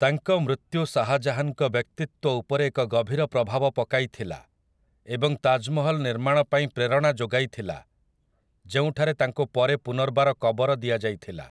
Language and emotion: Odia, neutral